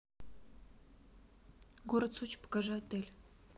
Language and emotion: Russian, neutral